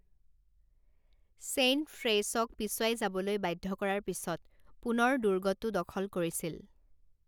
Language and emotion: Assamese, neutral